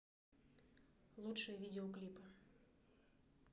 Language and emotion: Russian, neutral